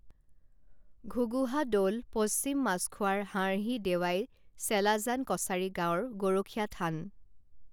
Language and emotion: Assamese, neutral